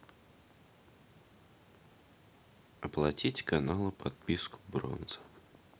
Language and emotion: Russian, neutral